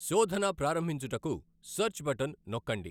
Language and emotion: Telugu, neutral